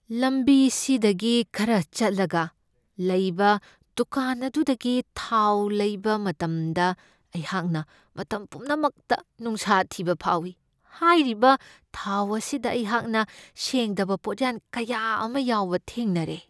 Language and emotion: Manipuri, fearful